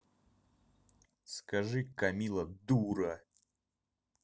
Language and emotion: Russian, angry